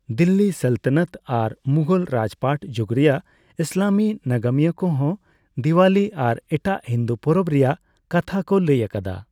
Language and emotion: Santali, neutral